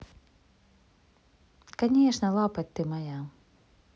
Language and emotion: Russian, positive